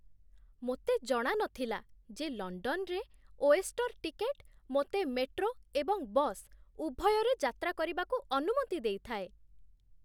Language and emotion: Odia, surprised